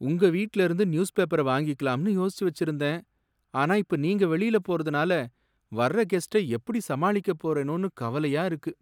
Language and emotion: Tamil, sad